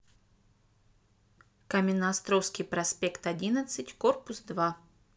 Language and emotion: Russian, neutral